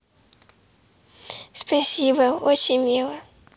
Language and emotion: Russian, positive